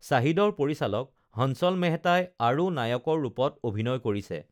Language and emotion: Assamese, neutral